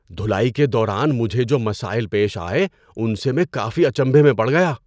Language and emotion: Urdu, surprised